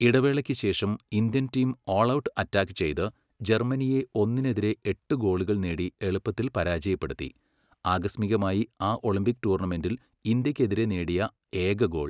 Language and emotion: Malayalam, neutral